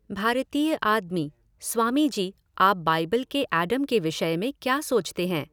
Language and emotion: Hindi, neutral